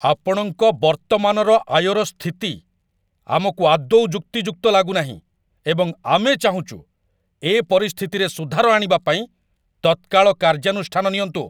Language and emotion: Odia, angry